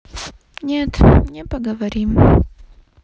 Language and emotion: Russian, sad